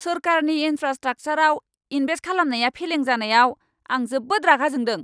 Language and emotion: Bodo, angry